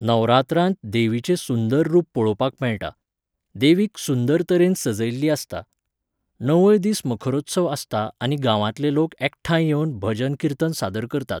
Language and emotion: Goan Konkani, neutral